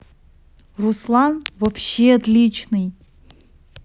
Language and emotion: Russian, positive